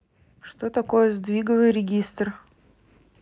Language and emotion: Russian, neutral